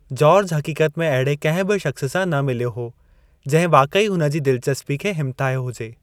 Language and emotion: Sindhi, neutral